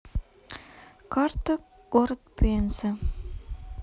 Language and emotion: Russian, neutral